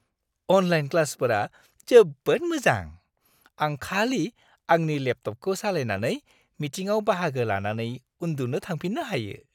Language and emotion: Bodo, happy